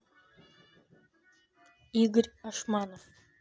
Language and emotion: Russian, neutral